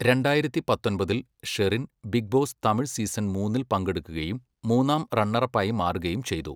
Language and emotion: Malayalam, neutral